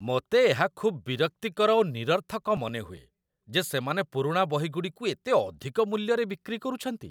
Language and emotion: Odia, disgusted